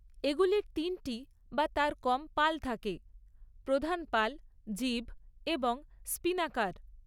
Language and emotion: Bengali, neutral